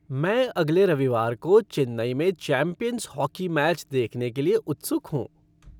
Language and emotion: Hindi, happy